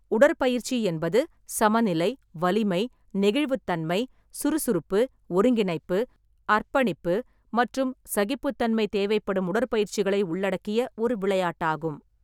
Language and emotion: Tamil, neutral